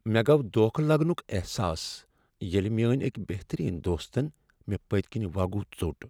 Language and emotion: Kashmiri, sad